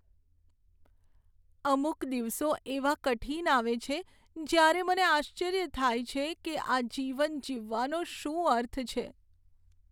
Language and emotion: Gujarati, sad